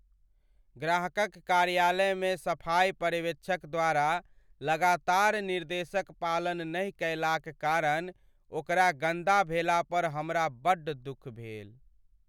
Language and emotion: Maithili, sad